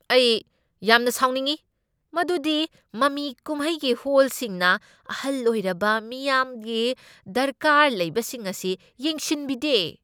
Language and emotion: Manipuri, angry